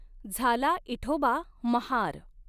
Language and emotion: Marathi, neutral